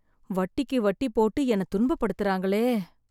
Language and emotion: Tamil, sad